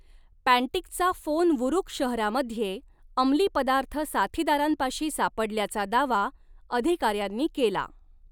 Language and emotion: Marathi, neutral